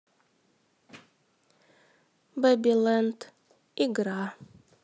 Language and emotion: Russian, neutral